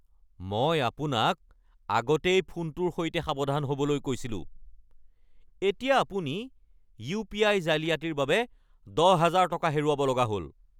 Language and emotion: Assamese, angry